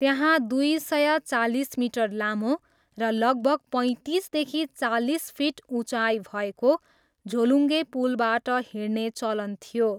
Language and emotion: Nepali, neutral